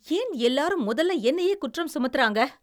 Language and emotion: Tamil, angry